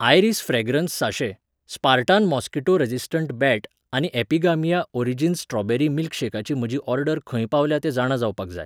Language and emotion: Goan Konkani, neutral